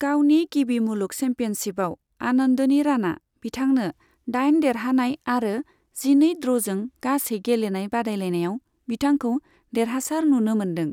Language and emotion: Bodo, neutral